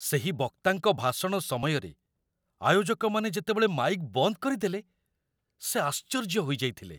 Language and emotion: Odia, surprised